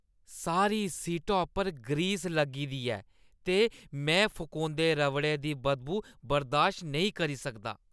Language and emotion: Dogri, disgusted